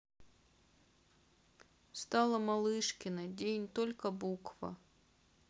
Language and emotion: Russian, sad